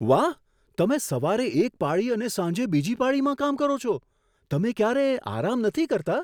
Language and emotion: Gujarati, surprised